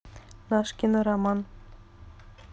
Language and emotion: Russian, neutral